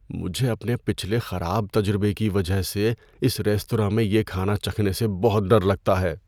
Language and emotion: Urdu, fearful